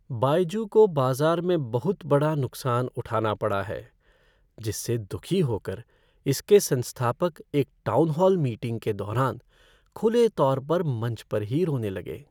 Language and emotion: Hindi, sad